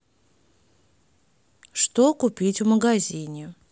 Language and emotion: Russian, neutral